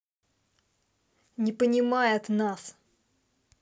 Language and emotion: Russian, angry